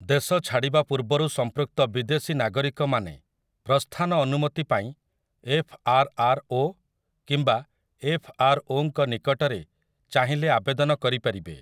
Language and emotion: Odia, neutral